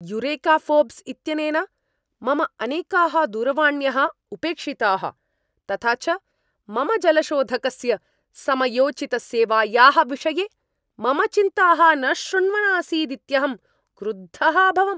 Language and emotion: Sanskrit, angry